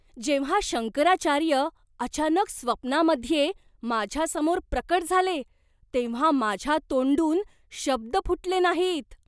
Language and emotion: Marathi, surprised